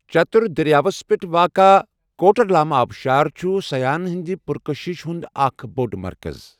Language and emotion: Kashmiri, neutral